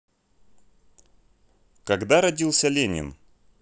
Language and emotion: Russian, neutral